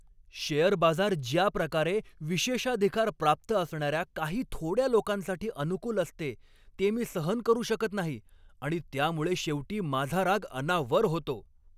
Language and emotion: Marathi, angry